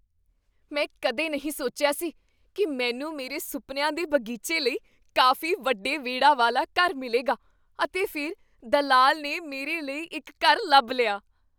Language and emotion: Punjabi, surprised